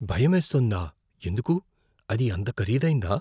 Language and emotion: Telugu, fearful